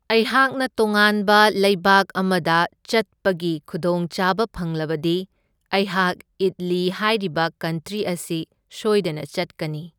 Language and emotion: Manipuri, neutral